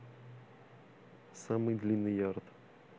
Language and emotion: Russian, neutral